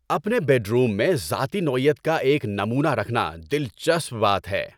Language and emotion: Urdu, happy